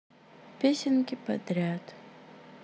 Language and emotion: Russian, sad